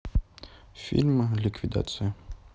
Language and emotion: Russian, neutral